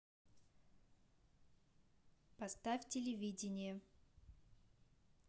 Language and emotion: Russian, neutral